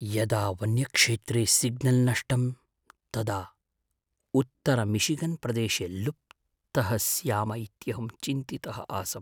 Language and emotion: Sanskrit, fearful